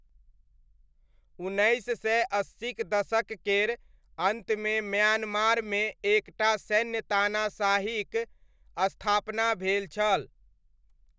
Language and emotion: Maithili, neutral